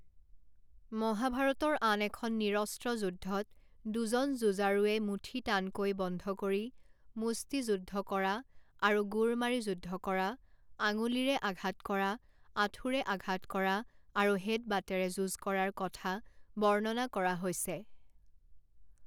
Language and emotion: Assamese, neutral